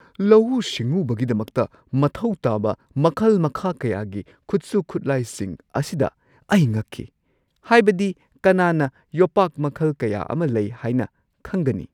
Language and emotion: Manipuri, surprised